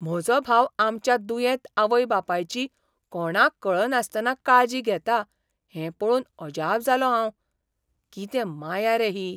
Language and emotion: Goan Konkani, surprised